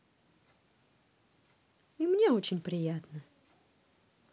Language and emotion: Russian, positive